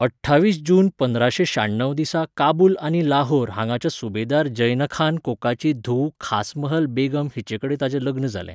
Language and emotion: Goan Konkani, neutral